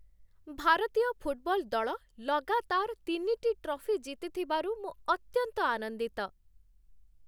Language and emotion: Odia, happy